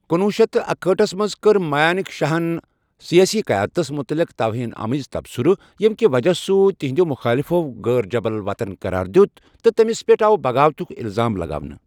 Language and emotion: Kashmiri, neutral